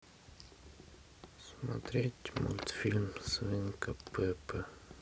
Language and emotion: Russian, sad